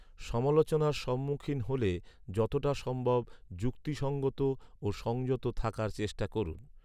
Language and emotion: Bengali, neutral